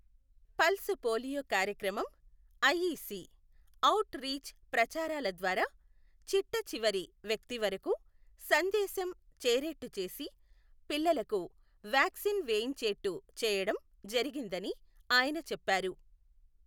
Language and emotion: Telugu, neutral